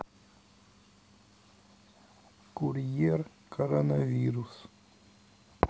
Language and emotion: Russian, neutral